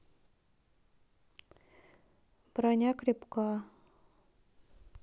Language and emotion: Russian, neutral